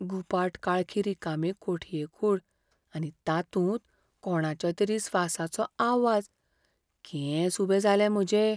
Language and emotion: Goan Konkani, fearful